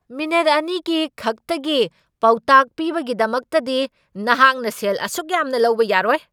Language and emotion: Manipuri, angry